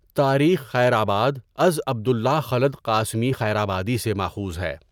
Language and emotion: Urdu, neutral